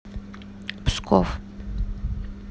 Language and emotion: Russian, neutral